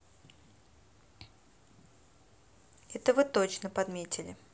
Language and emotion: Russian, neutral